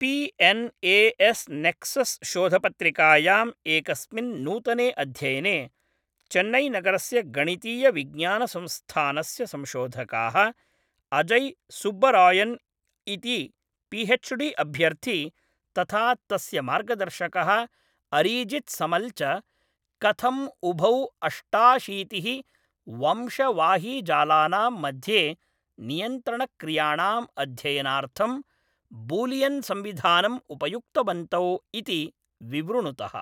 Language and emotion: Sanskrit, neutral